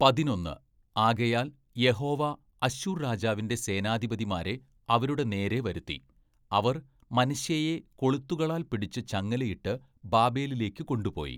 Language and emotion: Malayalam, neutral